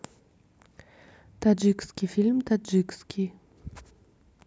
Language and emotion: Russian, neutral